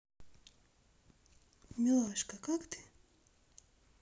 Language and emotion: Russian, neutral